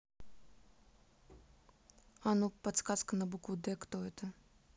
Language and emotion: Russian, neutral